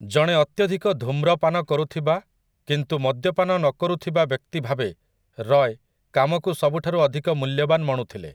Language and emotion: Odia, neutral